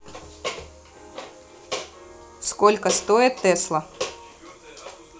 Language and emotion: Russian, neutral